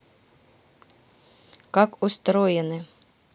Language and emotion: Russian, neutral